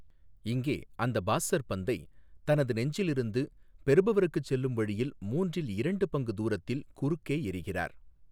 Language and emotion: Tamil, neutral